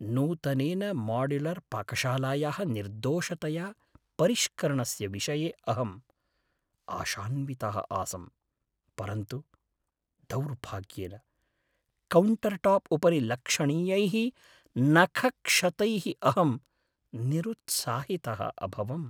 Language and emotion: Sanskrit, sad